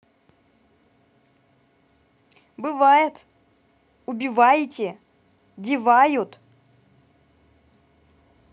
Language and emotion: Russian, neutral